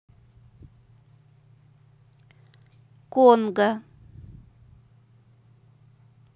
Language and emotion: Russian, neutral